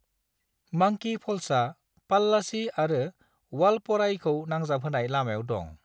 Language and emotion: Bodo, neutral